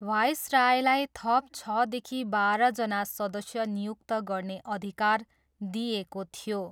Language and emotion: Nepali, neutral